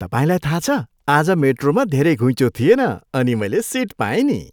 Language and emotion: Nepali, happy